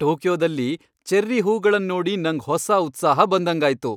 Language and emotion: Kannada, happy